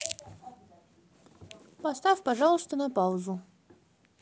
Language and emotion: Russian, neutral